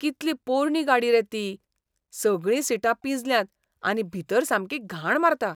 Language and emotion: Goan Konkani, disgusted